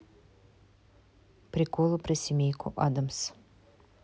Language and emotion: Russian, neutral